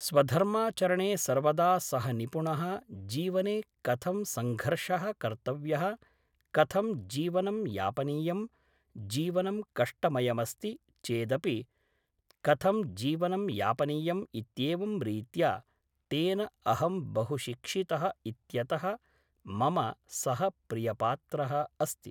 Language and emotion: Sanskrit, neutral